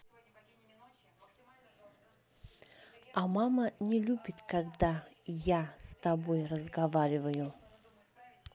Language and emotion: Russian, neutral